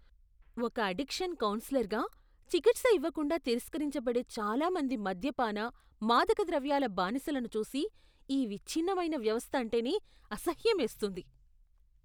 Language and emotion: Telugu, disgusted